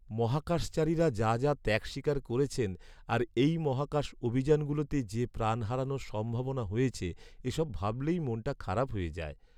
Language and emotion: Bengali, sad